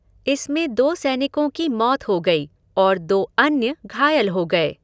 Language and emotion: Hindi, neutral